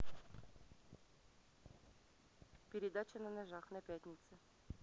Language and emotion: Russian, neutral